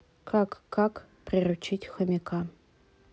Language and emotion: Russian, neutral